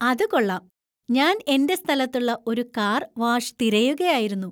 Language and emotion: Malayalam, happy